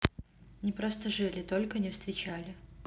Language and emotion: Russian, neutral